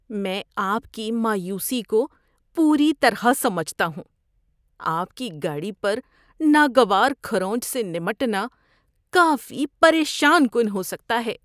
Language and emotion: Urdu, disgusted